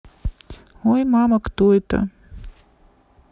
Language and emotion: Russian, neutral